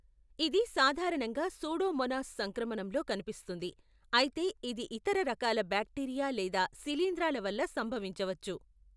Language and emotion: Telugu, neutral